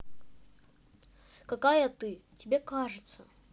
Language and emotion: Russian, neutral